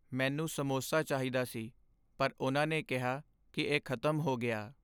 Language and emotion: Punjabi, sad